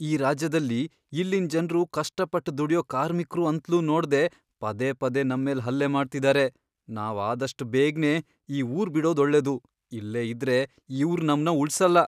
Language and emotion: Kannada, fearful